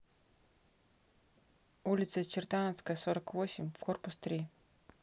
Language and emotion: Russian, neutral